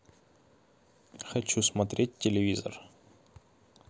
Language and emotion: Russian, neutral